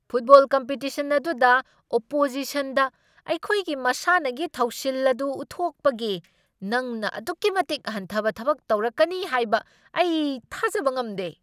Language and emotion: Manipuri, angry